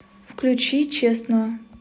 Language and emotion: Russian, neutral